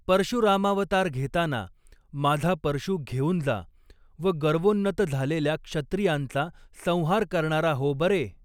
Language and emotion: Marathi, neutral